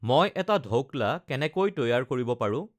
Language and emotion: Assamese, neutral